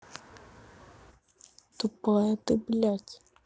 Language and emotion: Russian, neutral